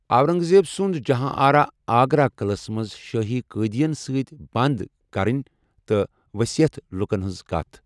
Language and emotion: Kashmiri, neutral